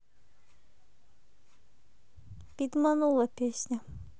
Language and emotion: Russian, neutral